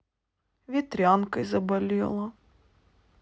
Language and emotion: Russian, sad